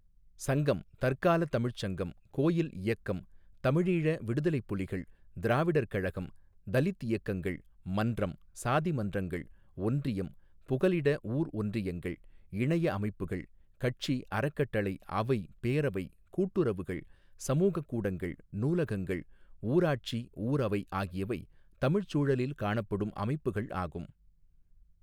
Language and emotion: Tamil, neutral